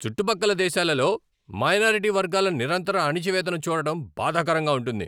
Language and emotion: Telugu, angry